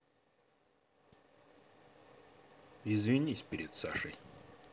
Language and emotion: Russian, neutral